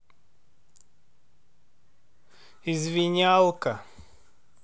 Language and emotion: Russian, neutral